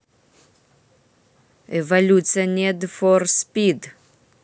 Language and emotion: Russian, neutral